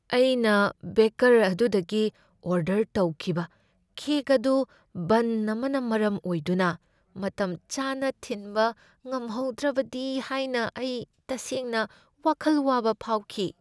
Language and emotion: Manipuri, fearful